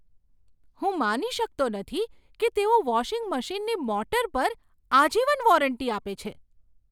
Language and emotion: Gujarati, surprised